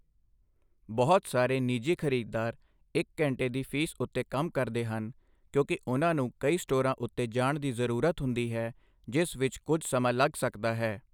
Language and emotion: Punjabi, neutral